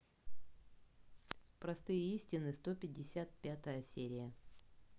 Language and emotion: Russian, neutral